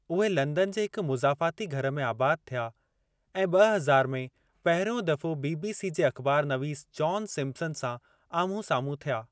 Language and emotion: Sindhi, neutral